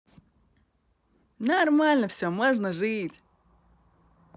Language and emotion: Russian, positive